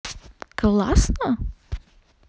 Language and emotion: Russian, positive